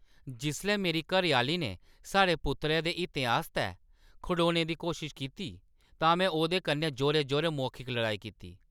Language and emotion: Dogri, angry